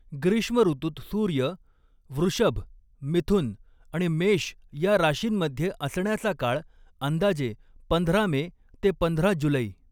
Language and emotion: Marathi, neutral